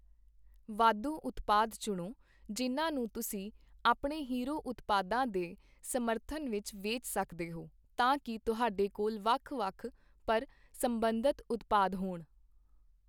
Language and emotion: Punjabi, neutral